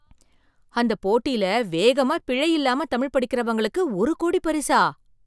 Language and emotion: Tamil, surprised